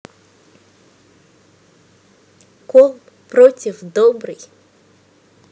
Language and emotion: Russian, neutral